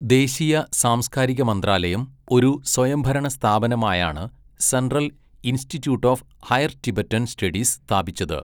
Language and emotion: Malayalam, neutral